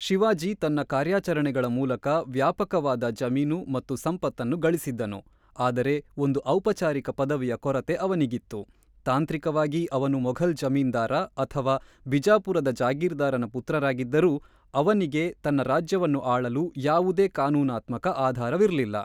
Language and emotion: Kannada, neutral